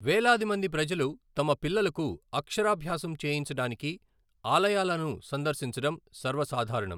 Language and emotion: Telugu, neutral